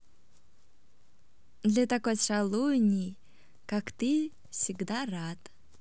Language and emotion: Russian, positive